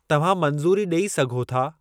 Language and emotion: Sindhi, neutral